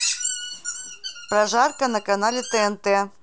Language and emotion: Russian, neutral